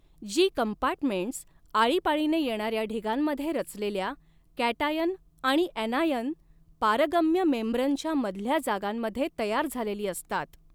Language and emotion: Marathi, neutral